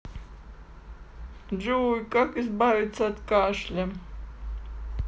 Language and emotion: Russian, sad